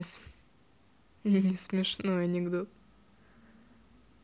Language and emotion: Russian, positive